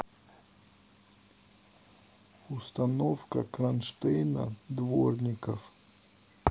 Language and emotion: Russian, neutral